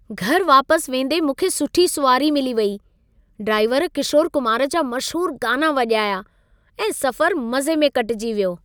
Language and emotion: Sindhi, happy